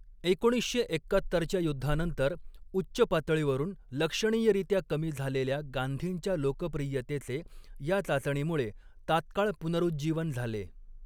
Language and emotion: Marathi, neutral